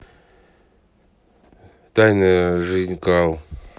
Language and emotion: Russian, neutral